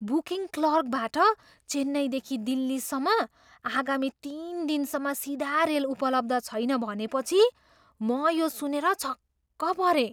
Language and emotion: Nepali, surprised